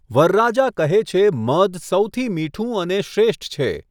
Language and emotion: Gujarati, neutral